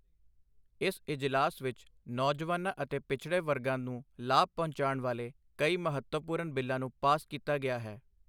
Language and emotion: Punjabi, neutral